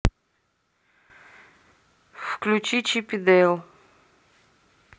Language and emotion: Russian, neutral